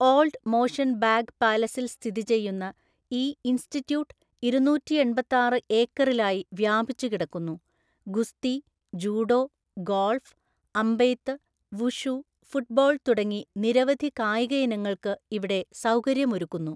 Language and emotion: Malayalam, neutral